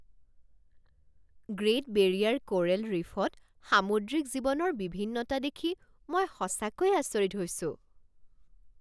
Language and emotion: Assamese, surprised